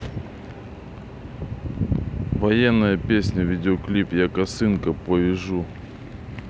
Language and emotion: Russian, neutral